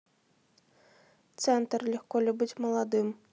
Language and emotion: Russian, neutral